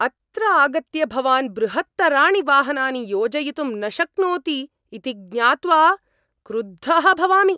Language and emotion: Sanskrit, angry